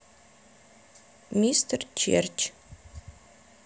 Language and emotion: Russian, neutral